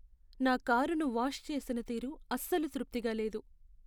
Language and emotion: Telugu, sad